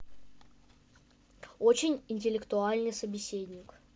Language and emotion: Russian, positive